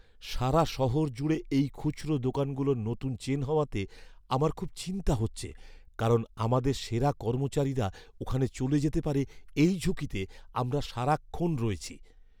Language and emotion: Bengali, fearful